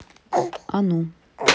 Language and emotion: Russian, neutral